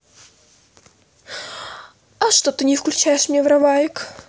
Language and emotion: Russian, neutral